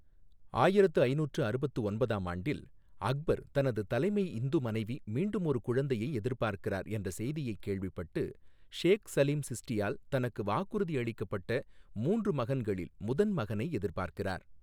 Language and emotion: Tamil, neutral